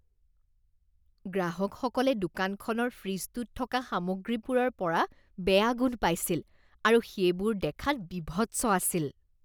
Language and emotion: Assamese, disgusted